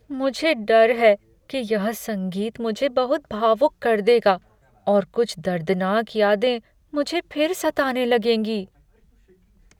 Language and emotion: Hindi, fearful